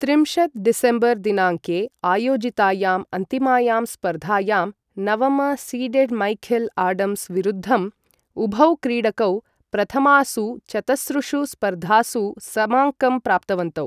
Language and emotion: Sanskrit, neutral